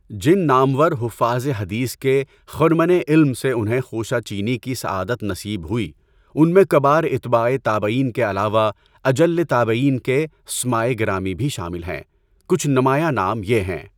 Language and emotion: Urdu, neutral